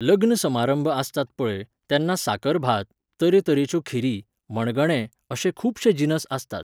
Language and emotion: Goan Konkani, neutral